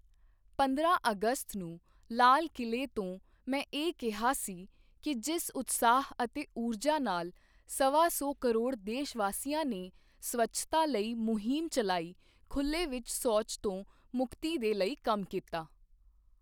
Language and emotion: Punjabi, neutral